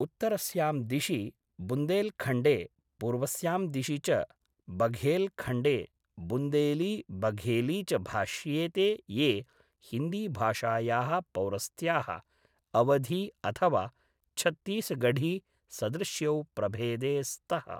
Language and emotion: Sanskrit, neutral